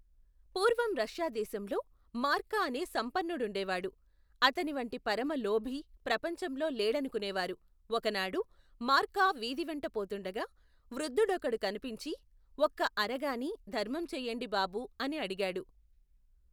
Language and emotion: Telugu, neutral